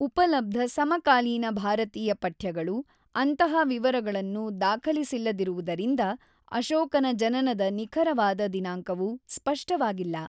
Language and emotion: Kannada, neutral